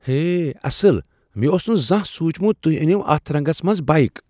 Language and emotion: Kashmiri, surprised